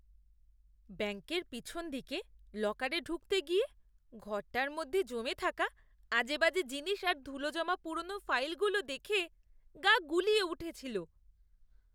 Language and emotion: Bengali, disgusted